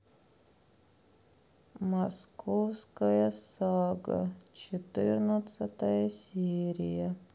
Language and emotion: Russian, sad